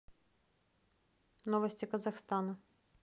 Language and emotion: Russian, neutral